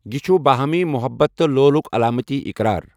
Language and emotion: Kashmiri, neutral